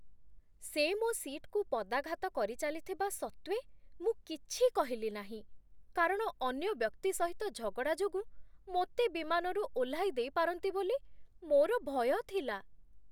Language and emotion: Odia, fearful